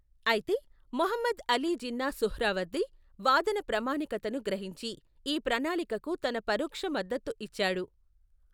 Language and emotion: Telugu, neutral